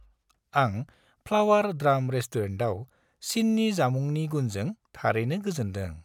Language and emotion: Bodo, happy